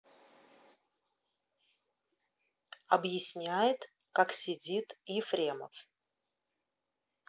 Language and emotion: Russian, neutral